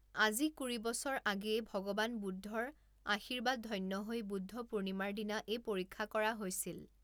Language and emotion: Assamese, neutral